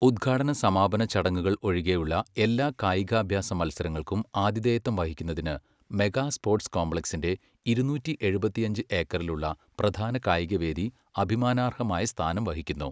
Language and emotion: Malayalam, neutral